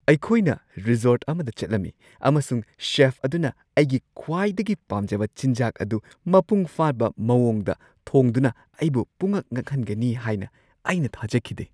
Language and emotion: Manipuri, surprised